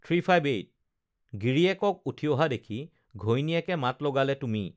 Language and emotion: Assamese, neutral